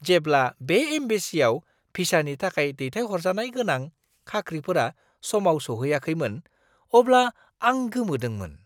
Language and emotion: Bodo, surprised